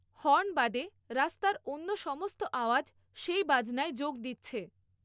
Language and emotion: Bengali, neutral